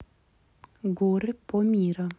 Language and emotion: Russian, neutral